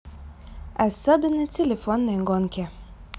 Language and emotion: Russian, positive